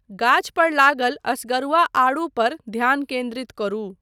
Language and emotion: Maithili, neutral